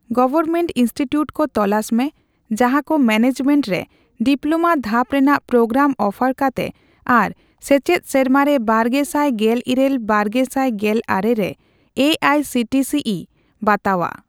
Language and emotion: Santali, neutral